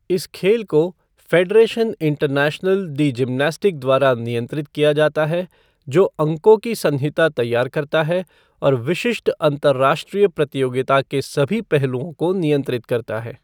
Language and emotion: Hindi, neutral